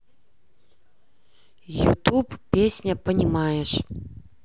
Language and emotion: Russian, neutral